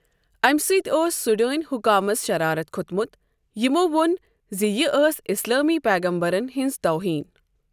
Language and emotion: Kashmiri, neutral